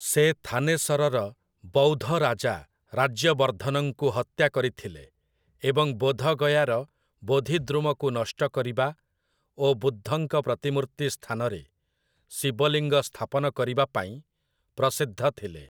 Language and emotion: Odia, neutral